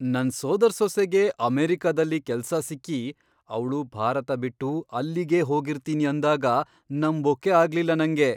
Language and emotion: Kannada, surprised